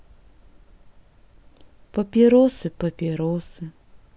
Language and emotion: Russian, sad